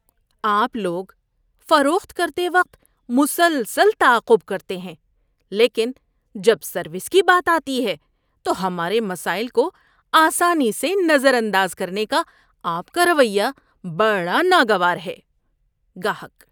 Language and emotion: Urdu, disgusted